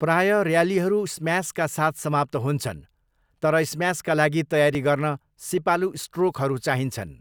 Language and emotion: Nepali, neutral